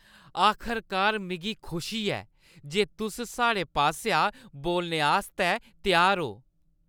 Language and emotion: Dogri, happy